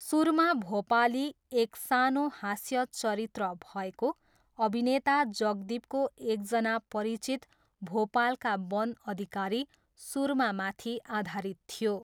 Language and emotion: Nepali, neutral